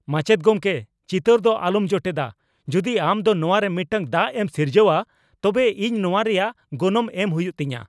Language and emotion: Santali, angry